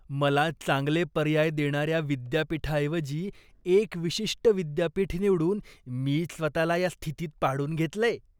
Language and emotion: Marathi, disgusted